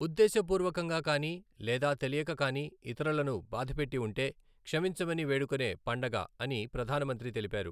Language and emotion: Telugu, neutral